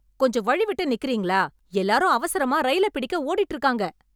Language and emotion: Tamil, angry